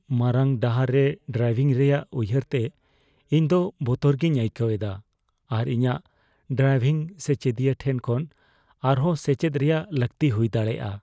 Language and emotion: Santali, fearful